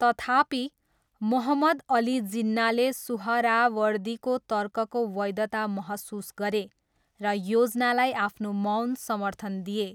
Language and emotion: Nepali, neutral